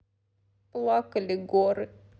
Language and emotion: Russian, sad